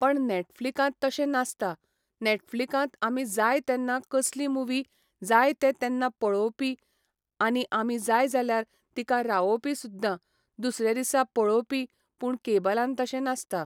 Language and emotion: Goan Konkani, neutral